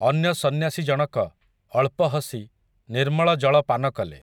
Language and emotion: Odia, neutral